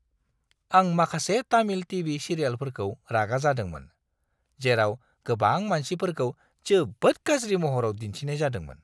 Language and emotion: Bodo, disgusted